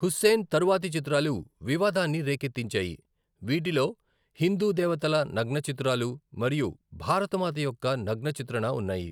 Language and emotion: Telugu, neutral